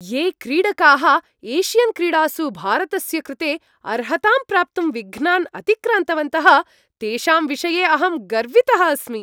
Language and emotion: Sanskrit, happy